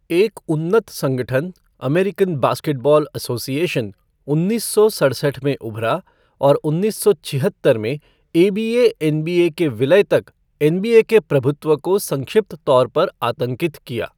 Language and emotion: Hindi, neutral